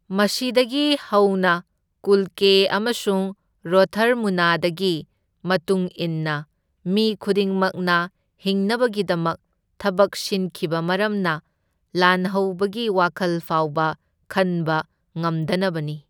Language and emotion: Manipuri, neutral